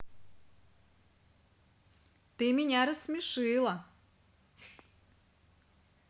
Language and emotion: Russian, positive